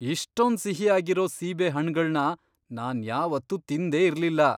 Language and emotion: Kannada, surprised